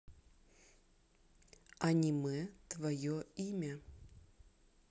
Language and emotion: Russian, neutral